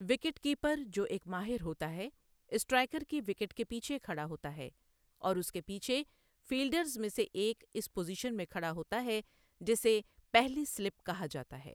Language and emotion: Urdu, neutral